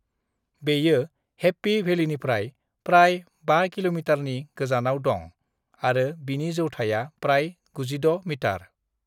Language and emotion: Bodo, neutral